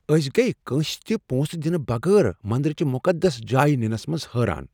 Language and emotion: Kashmiri, surprised